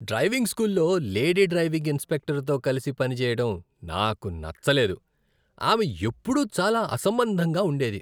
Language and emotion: Telugu, disgusted